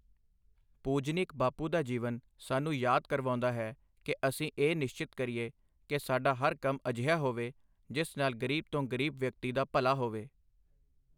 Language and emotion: Punjabi, neutral